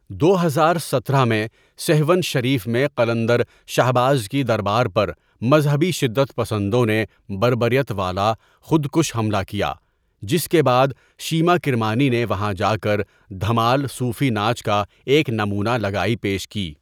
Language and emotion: Urdu, neutral